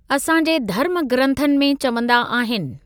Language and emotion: Sindhi, neutral